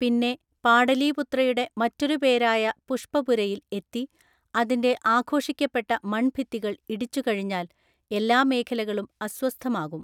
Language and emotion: Malayalam, neutral